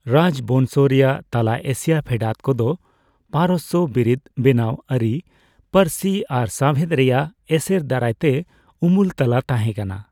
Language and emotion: Santali, neutral